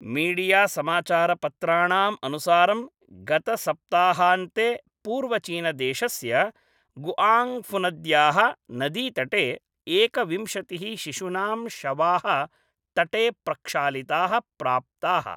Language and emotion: Sanskrit, neutral